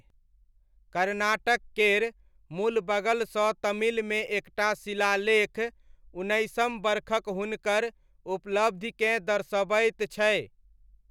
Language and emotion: Maithili, neutral